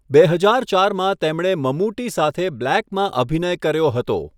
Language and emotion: Gujarati, neutral